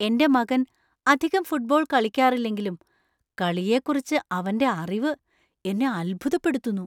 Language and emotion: Malayalam, surprised